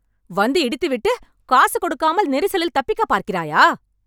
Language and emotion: Tamil, angry